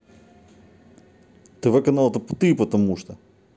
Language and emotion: Russian, angry